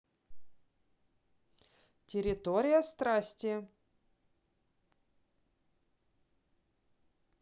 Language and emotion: Russian, neutral